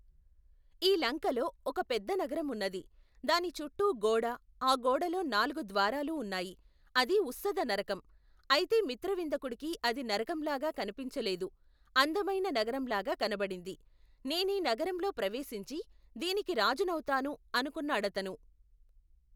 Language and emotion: Telugu, neutral